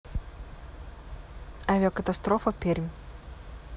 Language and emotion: Russian, neutral